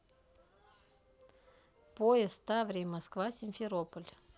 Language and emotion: Russian, neutral